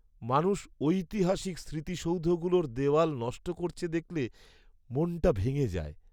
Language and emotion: Bengali, sad